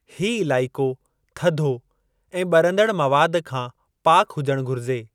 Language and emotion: Sindhi, neutral